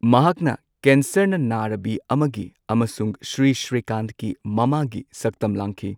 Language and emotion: Manipuri, neutral